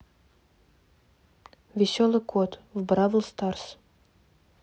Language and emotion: Russian, neutral